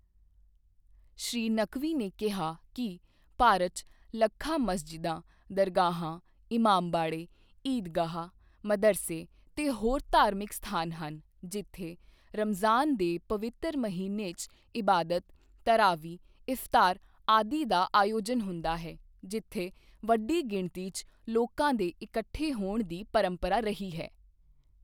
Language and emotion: Punjabi, neutral